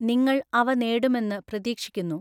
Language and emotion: Malayalam, neutral